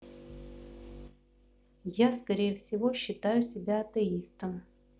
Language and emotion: Russian, neutral